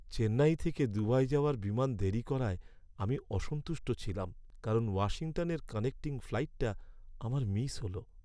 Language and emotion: Bengali, sad